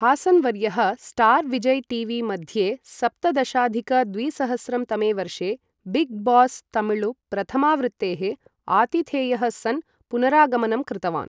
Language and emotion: Sanskrit, neutral